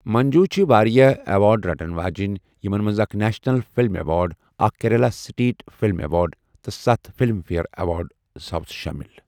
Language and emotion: Kashmiri, neutral